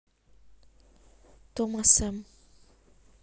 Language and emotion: Russian, neutral